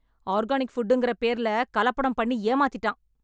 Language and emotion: Tamil, angry